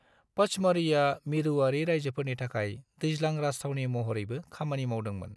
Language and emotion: Bodo, neutral